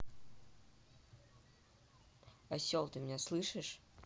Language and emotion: Russian, angry